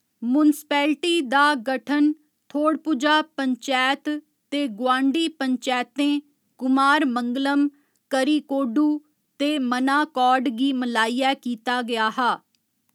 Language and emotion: Dogri, neutral